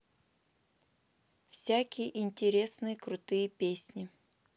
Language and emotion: Russian, neutral